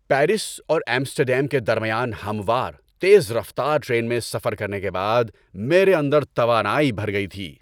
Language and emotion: Urdu, happy